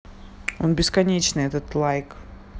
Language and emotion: Russian, neutral